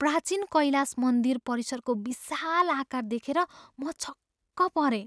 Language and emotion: Nepali, surprised